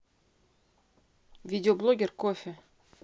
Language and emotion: Russian, neutral